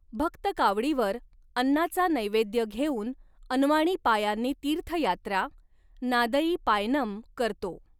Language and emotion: Marathi, neutral